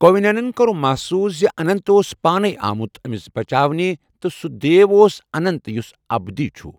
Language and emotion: Kashmiri, neutral